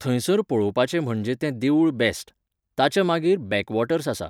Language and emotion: Goan Konkani, neutral